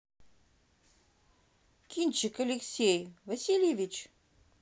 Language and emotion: Russian, neutral